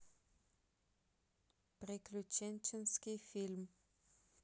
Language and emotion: Russian, neutral